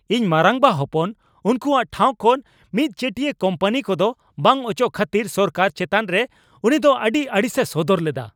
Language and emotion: Santali, angry